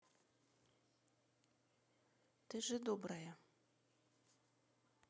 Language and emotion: Russian, neutral